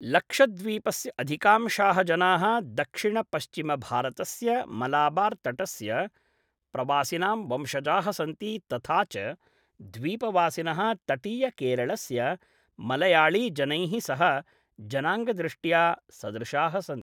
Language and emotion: Sanskrit, neutral